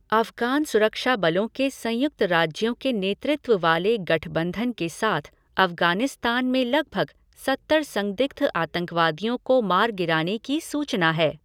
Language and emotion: Hindi, neutral